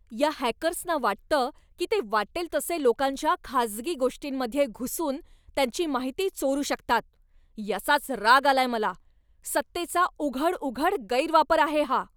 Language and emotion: Marathi, angry